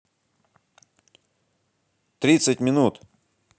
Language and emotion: Russian, positive